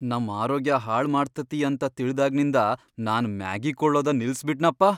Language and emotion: Kannada, fearful